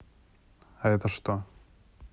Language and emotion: Russian, neutral